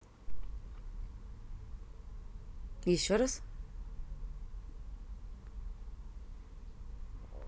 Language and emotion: Russian, neutral